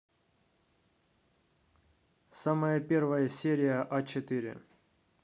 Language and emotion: Russian, neutral